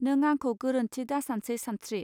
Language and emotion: Bodo, neutral